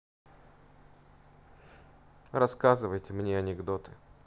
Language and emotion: Russian, neutral